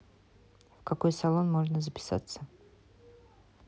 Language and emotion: Russian, neutral